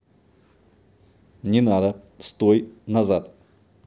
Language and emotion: Russian, neutral